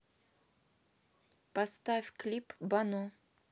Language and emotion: Russian, neutral